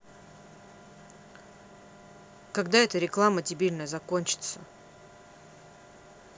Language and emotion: Russian, angry